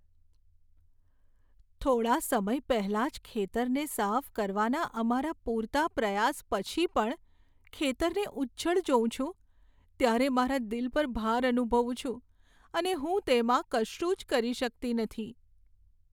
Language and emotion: Gujarati, sad